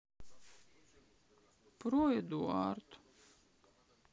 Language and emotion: Russian, sad